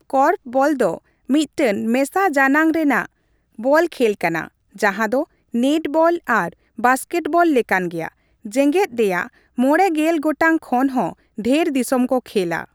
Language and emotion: Santali, neutral